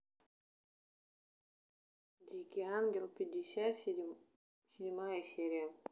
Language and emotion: Russian, neutral